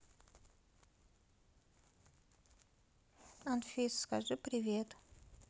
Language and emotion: Russian, sad